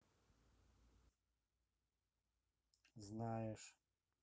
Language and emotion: Russian, neutral